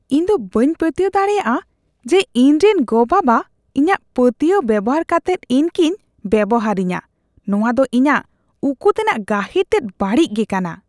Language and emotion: Santali, disgusted